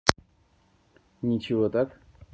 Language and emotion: Russian, neutral